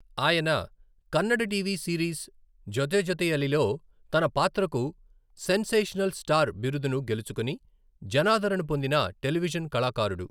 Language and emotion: Telugu, neutral